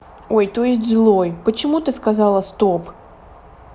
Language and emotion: Russian, neutral